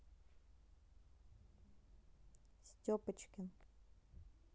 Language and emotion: Russian, neutral